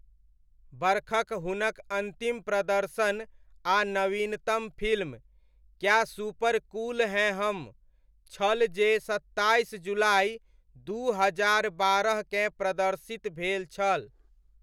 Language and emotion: Maithili, neutral